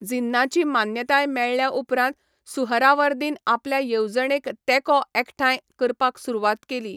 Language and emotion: Goan Konkani, neutral